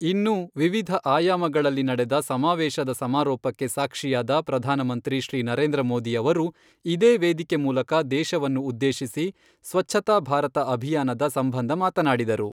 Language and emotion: Kannada, neutral